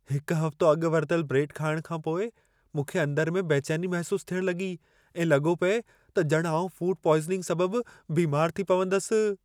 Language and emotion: Sindhi, fearful